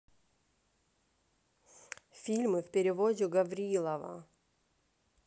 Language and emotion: Russian, neutral